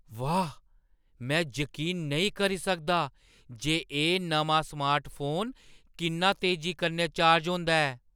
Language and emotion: Dogri, surprised